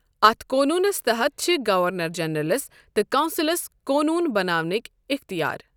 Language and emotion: Kashmiri, neutral